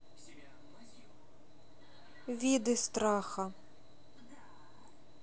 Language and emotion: Russian, neutral